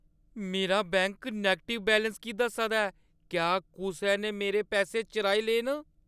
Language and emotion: Dogri, fearful